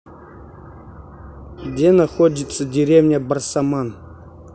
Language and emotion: Russian, neutral